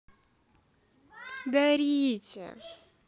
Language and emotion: Russian, positive